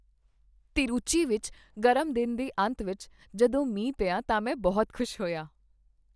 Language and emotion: Punjabi, happy